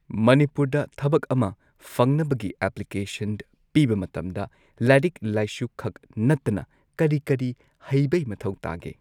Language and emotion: Manipuri, neutral